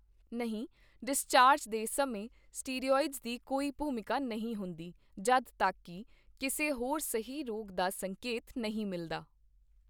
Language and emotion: Punjabi, neutral